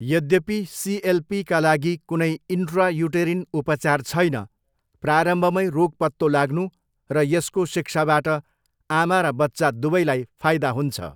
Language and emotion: Nepali, neutral